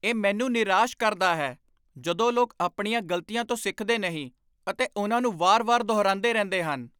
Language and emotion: Punjabi, angry